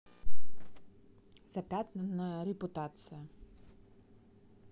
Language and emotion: Russian, neutral